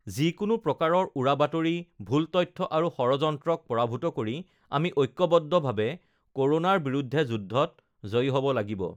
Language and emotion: Assamese, neutral